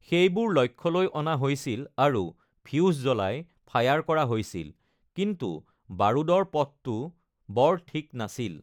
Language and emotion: Assamese, neutral